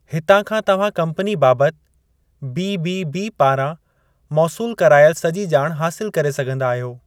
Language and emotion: Sindhi, neutral